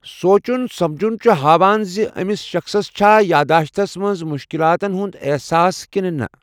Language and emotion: Kashmiri, neutral